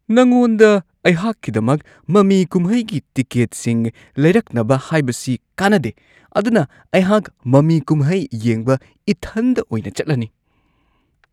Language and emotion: Manipuri, disgusted